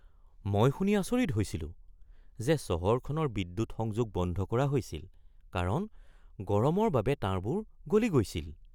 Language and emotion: Assamese, surprised